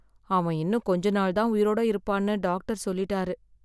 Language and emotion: Tamil, sad